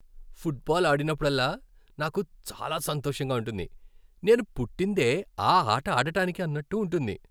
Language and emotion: Telugu, happy